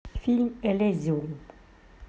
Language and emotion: Russian, neutral